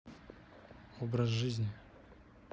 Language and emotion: Russian, neutral